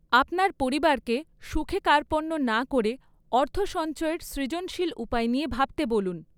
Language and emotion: Bengali, neutral